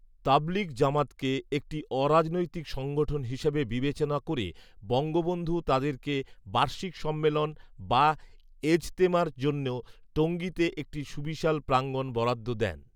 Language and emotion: Bengali, neutral